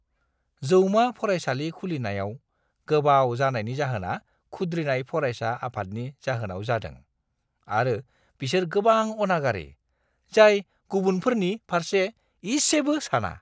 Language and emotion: Bodo, disgusted